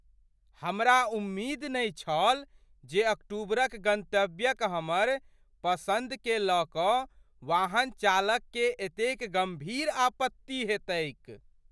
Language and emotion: Maithili, surprised